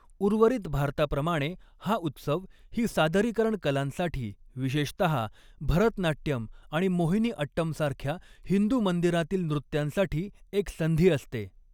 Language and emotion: Marathi, neutral